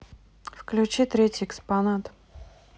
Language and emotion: Russian, neutral